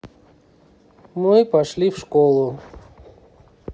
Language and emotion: Russian, neutral